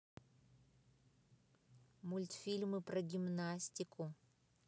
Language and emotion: Russian, neutral